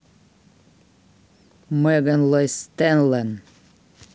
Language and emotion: Russian, neutral